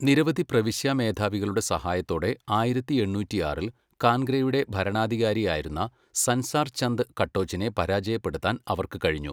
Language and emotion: Malayalam, neutral